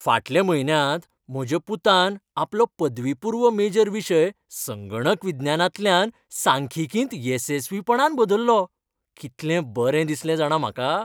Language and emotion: Goan Konkani, happy